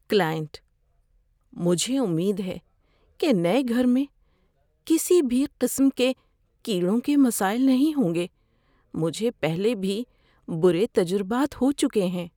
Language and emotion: Urdu, fearful